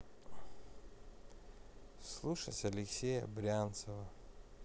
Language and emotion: Russian, sad